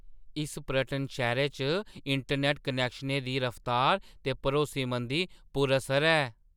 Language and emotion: Dogri, surprised